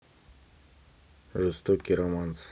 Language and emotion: Russian, neutral